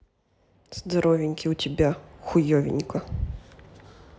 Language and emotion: Russian, neutral